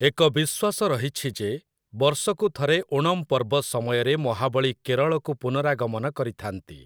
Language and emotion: Odia, neutral